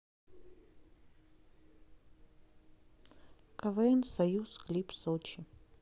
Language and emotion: Russian, neutral